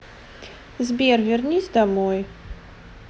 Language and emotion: Russian, neutral